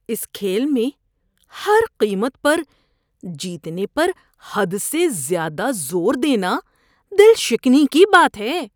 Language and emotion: Urdu, disgusted